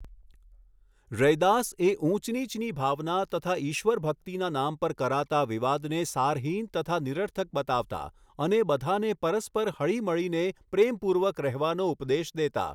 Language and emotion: Gujarati, neutral